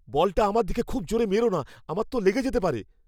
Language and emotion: Bengali, fearful